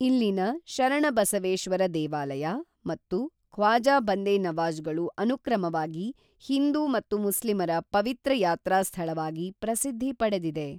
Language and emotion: Kannada, neutral